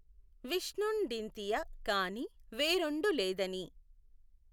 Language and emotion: Telugu, neutral